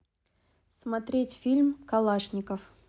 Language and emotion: Russian, neutral